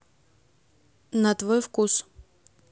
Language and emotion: Russian, neutral